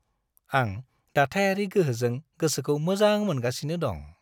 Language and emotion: Bodo, happy